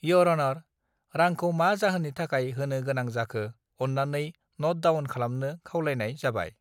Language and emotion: Bodo, neutral